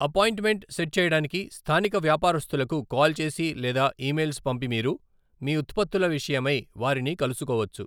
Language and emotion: Telugu, neutral